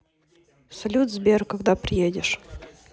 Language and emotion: Russian, neutral